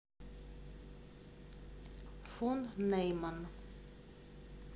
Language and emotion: Russian, neutral